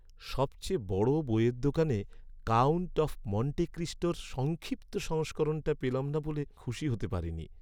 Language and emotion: Bengali, sad